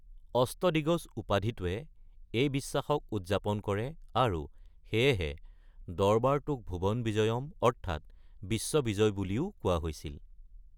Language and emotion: Assamese, neutral